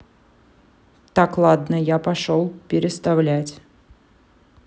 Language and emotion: Russian, neutral